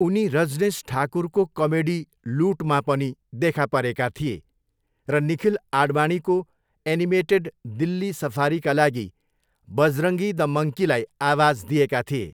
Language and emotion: Nepali, neutral